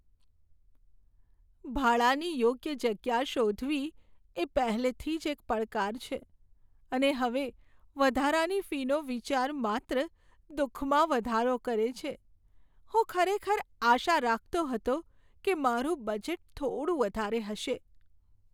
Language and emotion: Gujarati, sad